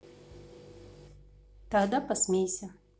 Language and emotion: Russian, neutral